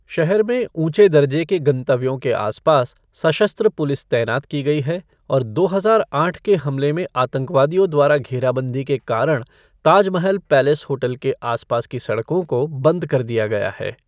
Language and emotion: Hindi, neutral